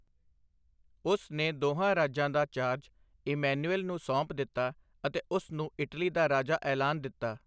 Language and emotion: Punjabi, neutral